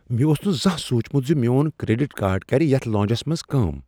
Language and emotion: Kashmiri, surprised